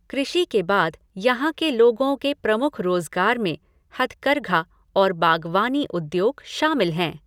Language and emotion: Hindi, neutral